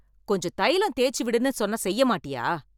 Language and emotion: Tamil, angry